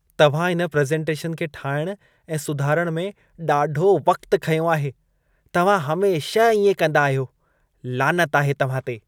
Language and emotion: Sindhi, disgusted